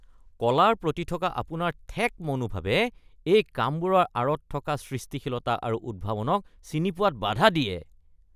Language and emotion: Assamese, disgusted